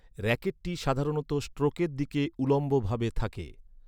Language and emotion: Bengali, neutral